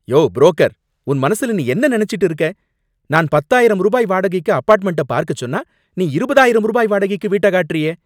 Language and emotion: Tamil, angry